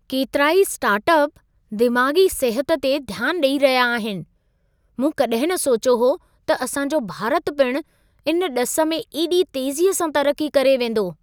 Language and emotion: Sindhi, surprised